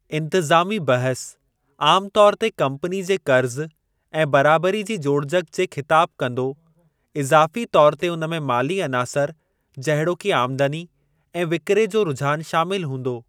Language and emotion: Sindhi, neutral